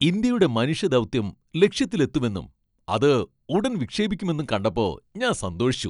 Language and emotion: Malayalam, happy